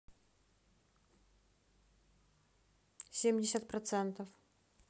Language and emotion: Russian, neutral